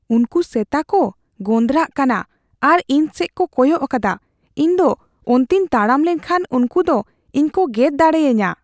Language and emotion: Santali, fearful